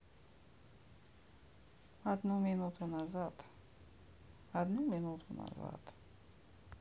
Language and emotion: Russian, sad